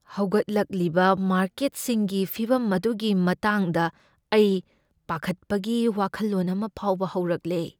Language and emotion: Manipuri, fearful